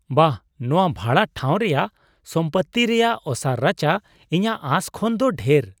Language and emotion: Santali, surprised